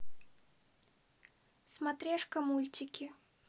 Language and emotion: Russian, neutral